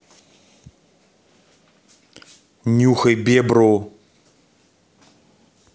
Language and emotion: Russian, neutral